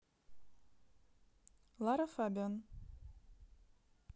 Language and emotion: Russian, neutral